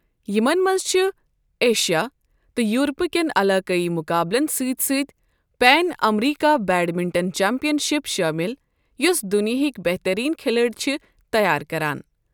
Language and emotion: Kashmiri, neutral